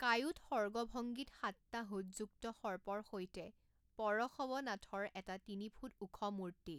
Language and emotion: Assamese, neutral